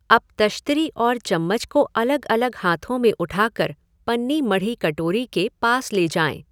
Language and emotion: Hindi, neutral